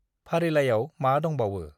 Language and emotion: Bodo, neutral